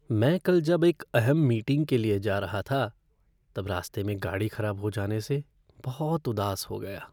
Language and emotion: Hindi, sad